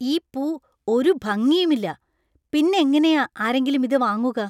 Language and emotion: Malayalam, disgusted